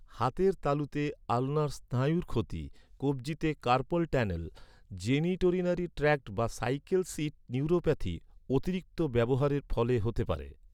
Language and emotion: Bengali, neutral